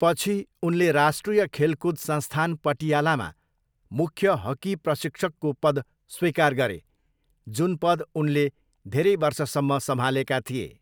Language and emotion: Nepali, neutral